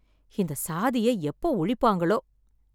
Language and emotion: Tamil, sad